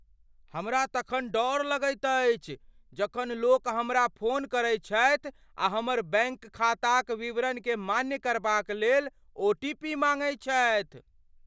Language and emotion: Maithili, fearful